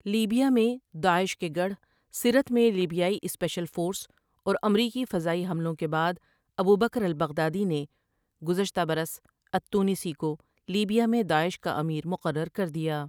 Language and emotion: Urdu, neutral